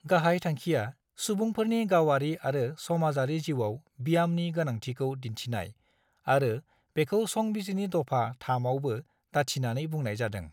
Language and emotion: Bodo, neutral